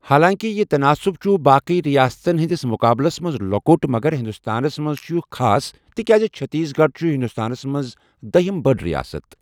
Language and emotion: Kashmiri, neutral